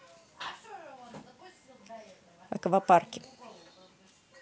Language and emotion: Russian, neutral